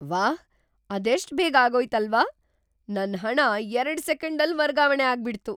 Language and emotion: Kannada, surprised